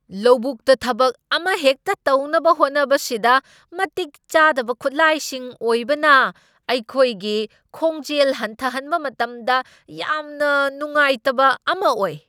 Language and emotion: Manipuri, angry